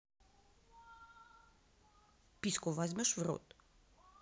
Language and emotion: Russian, neutral